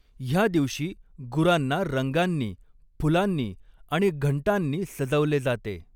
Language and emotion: Marathi, neutral